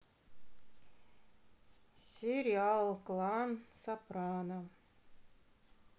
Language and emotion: Russian, sad